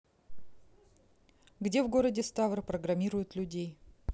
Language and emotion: Russian, neutral